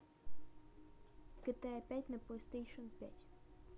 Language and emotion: Russian, neutral